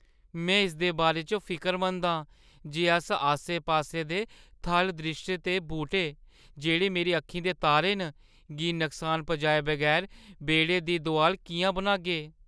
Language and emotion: Dogri, fearful